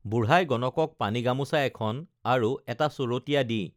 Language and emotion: Assamese, neutral